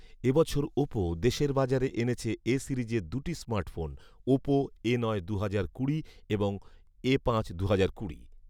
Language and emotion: Bengali, neutral